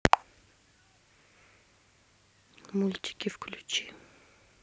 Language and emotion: Russian, neutral